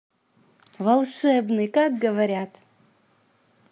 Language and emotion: Russian, positive